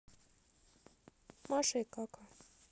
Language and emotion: Russian, neutral